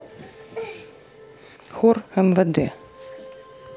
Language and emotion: Russian, neutral